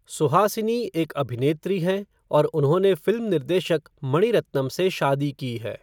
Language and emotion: Hindi, neutral